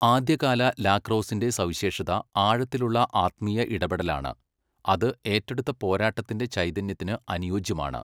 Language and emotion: Malayalam, neutral